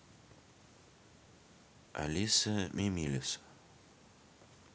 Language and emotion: Russian, neutral